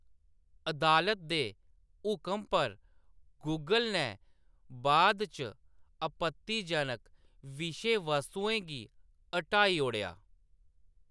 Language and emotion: Dogri, neutral